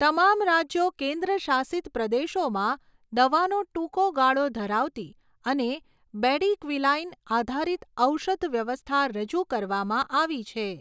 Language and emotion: Gujarati, neutral